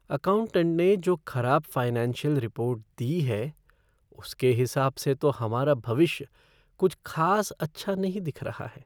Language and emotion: Hindi, sad